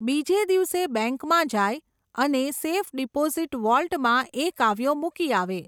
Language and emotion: Gujarati, neutral